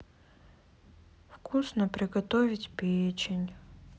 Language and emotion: Russian, sad